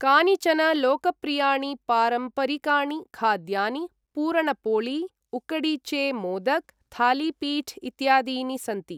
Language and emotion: Sanskrit, neutral